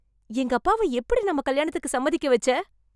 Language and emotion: Tamil, surprised